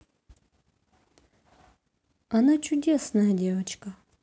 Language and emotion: Russian, neutral